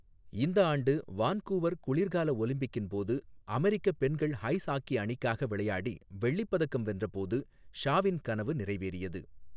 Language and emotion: Tamil, neutral